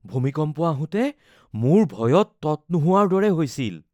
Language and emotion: Assamese, fearful